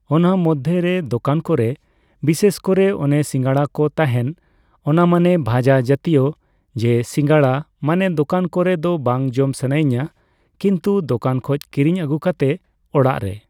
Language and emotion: Santali, neutral